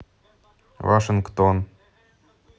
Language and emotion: Russian, neutral